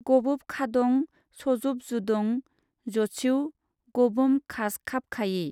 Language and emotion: Bodo, neutral